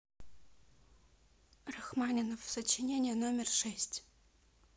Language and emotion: Russian, neutral